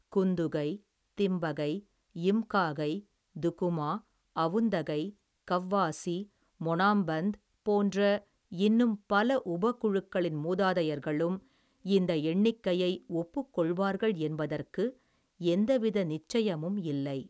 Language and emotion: Tamil, neutral